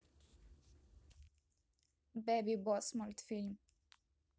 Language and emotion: Russian, neutral